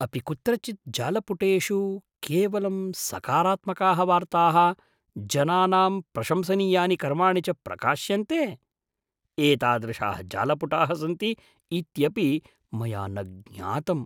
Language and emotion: Sanskrit, surprised